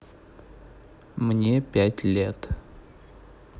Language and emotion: Russian, neutral